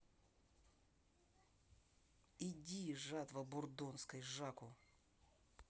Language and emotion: Russian, angry